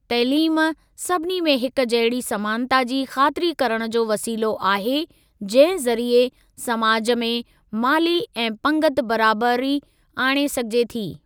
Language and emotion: Sindhi, neutral